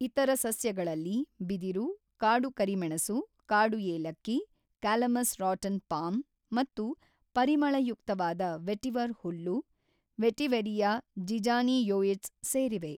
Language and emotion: Kannada, neutral